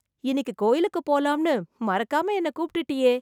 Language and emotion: Tamil, surprised